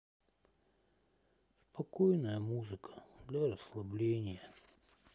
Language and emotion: Russian, sad